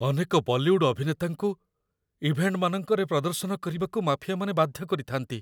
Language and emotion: Odia, fearful